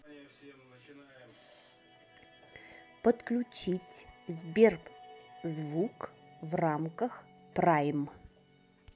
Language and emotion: Russian, neutral